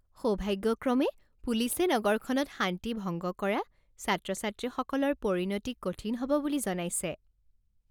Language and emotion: Assamese, happy